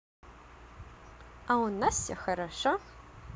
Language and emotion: Russian, positive